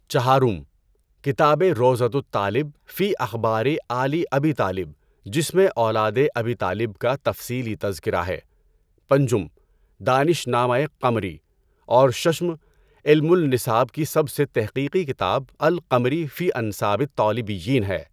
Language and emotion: Urdu, neutral